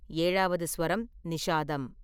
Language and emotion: Tamil, neutral